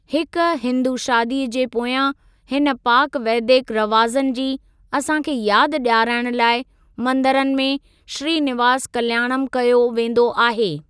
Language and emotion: Sindhi, neutral